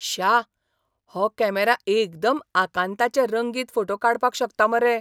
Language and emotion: Goan Konkani, surprised